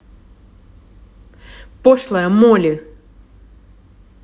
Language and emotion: Russian, angry